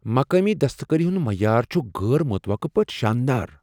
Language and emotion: Kashmiri, surprised